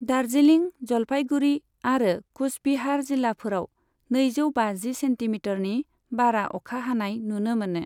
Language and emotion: Bodo, neutral